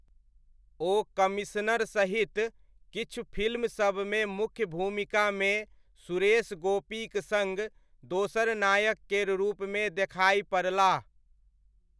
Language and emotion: Maithili, neutral